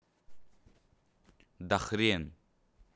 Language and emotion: Russian, angry